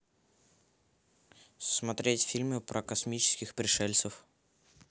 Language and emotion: Russian, neutral